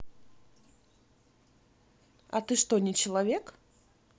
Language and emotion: Russian, neutral